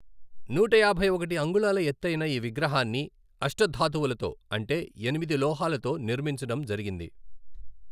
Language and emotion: Telugu, neutral